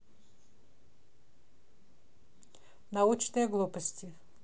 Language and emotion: Russian, neutral